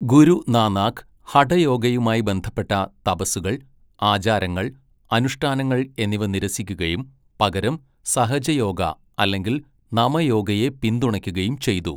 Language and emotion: Malayalam, neutral